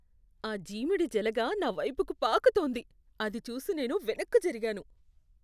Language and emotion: Telugu, disgusted